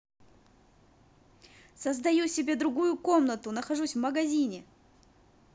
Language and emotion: Russian, positive